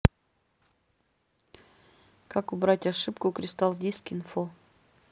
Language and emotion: Russian, neutral